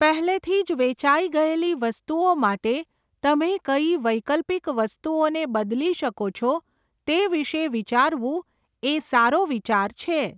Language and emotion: Gujarati, neutral